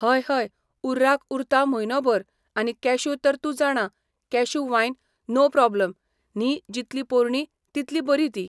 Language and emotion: Goan Konkani, neutral